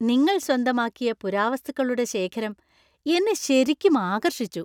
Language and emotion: Malayalam, happy